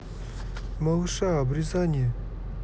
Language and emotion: Russian, neutral